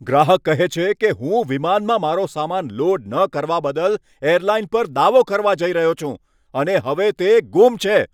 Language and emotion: Gujarati, angry